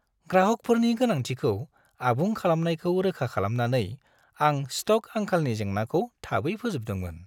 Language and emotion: Bodo, happy